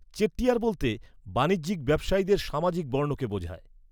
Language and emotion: Bengali, neutral